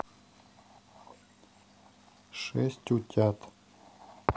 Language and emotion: Russian, neutral